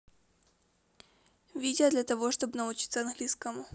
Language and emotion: Russian, neutral